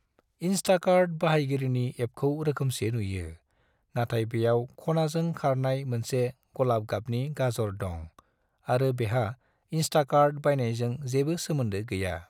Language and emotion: Bodo, neutral